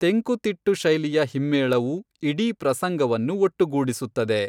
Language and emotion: Kannada, neutral